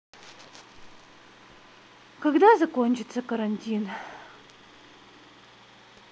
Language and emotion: Russian, sad